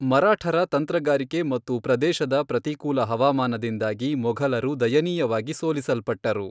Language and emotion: Kannada, neutral